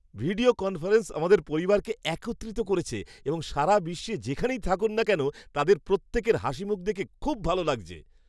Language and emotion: Bengali, happy